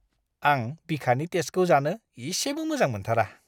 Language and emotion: Bodo, disgusted